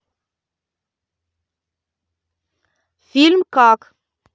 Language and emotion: Russian, neutral